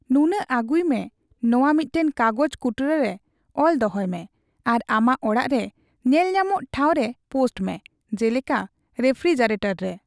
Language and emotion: Santali, neutral